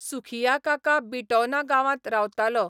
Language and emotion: Goan Konkani, neutral